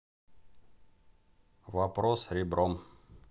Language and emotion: Russian, neutral